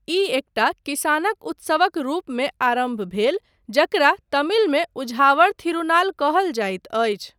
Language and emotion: Maithili, neutral